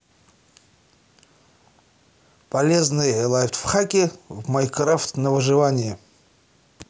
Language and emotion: Russian, positive